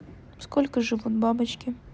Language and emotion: Russian, neutral